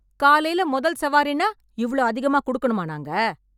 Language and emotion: Tamil, angry